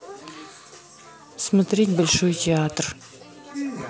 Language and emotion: Russian, neutral